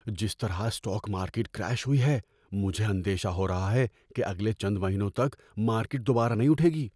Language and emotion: Urdu, fearful